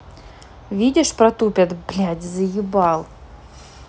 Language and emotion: Russian, angry